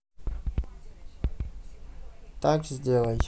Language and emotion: Russian, neutral